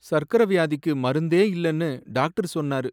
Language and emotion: Tamil, sad